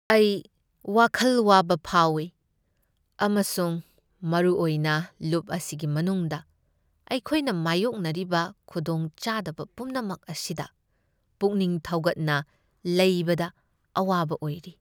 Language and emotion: Manipuri, sad